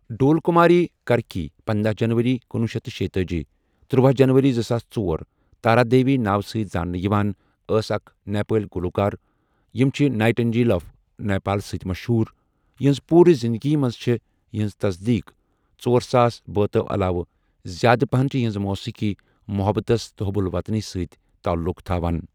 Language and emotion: Kashmiri, neutral